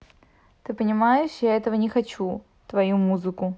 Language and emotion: Russian, neutral